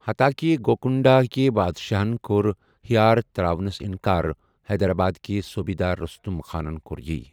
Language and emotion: Kashmiri, neutral